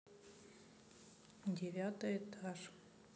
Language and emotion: Russian, neutral